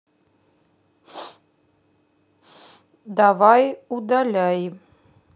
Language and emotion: Russian, neutral